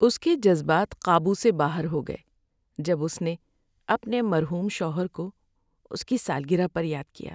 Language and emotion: Urdu, sad